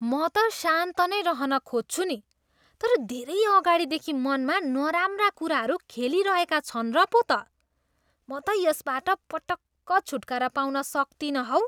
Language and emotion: Nepali, disgusted